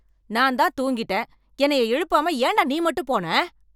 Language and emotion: Tamil, angry